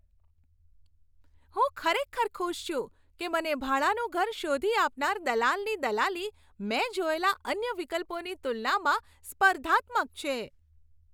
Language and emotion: Gujarati, happy